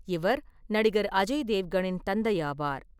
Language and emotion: Tamil, neutral